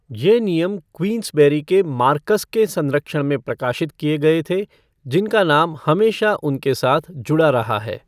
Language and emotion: Hindi, neutral